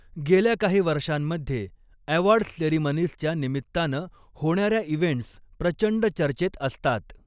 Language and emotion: Marathi, neutral